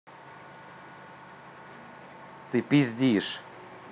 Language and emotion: Russian, angry